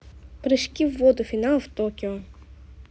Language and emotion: Russian, neutral